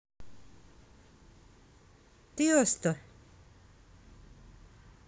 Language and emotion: Russian, neutral